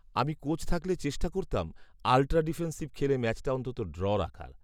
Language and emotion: Bengali, neutral